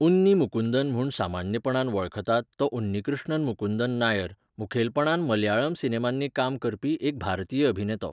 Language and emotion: Goan Konkani, neutral